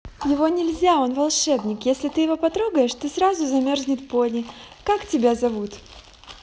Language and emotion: Russian, positive